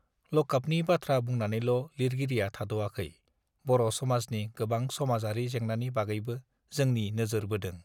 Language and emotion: Bodo, neutral